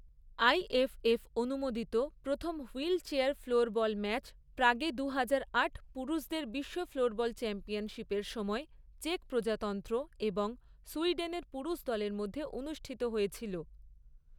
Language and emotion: Bengali, neutral